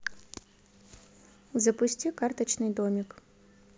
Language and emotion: Russian, neutral